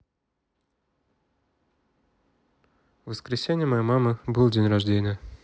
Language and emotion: Russian, neutral